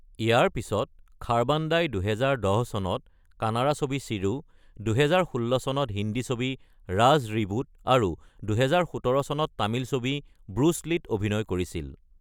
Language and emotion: Assamese, neutral